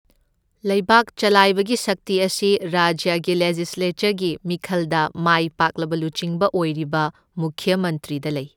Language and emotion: Manipuri, neutral